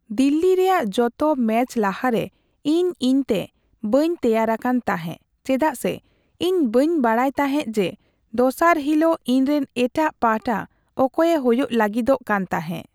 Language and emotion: Santali, neutral